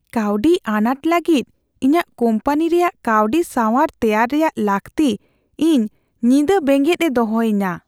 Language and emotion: Santali, fearful